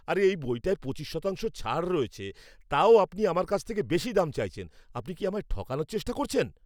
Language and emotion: Bengali, angry